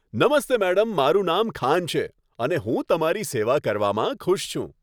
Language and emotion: Gujarati, happy